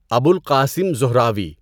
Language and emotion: Urdu, neutral